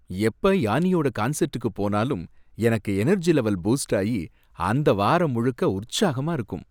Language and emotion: Tamil, happy